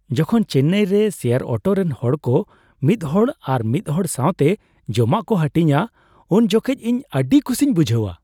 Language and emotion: Santali, happy